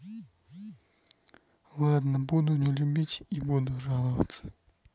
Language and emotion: Russian, sad